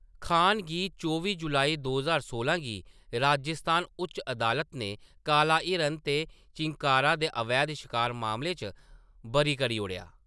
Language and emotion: Dogri, neutral